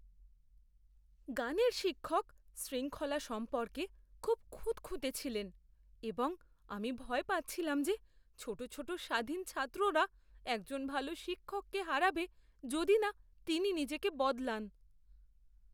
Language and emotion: Bengali, fearful